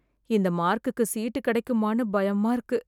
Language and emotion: Tamil, fearful